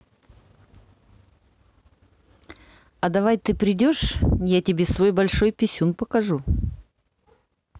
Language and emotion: Russian, neutral